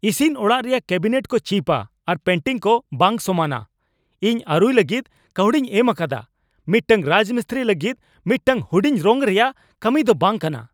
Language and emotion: Santali, angry